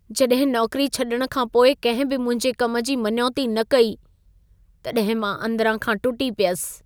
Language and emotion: Sindhi, sad